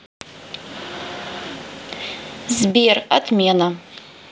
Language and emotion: Russian, neutral